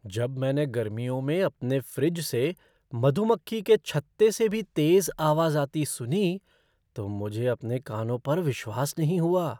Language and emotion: Hindi, surprised